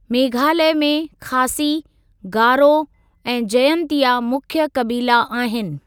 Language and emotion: Sindhi, neutral